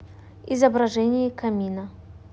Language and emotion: Russian, neutral